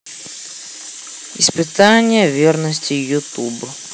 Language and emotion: Russian, neutral